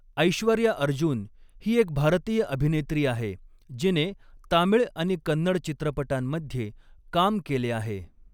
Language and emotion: Marathi, neutral